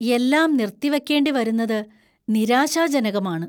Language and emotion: Malayalam, fearful